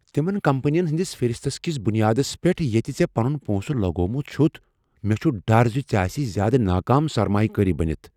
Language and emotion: Kashmiri, fearful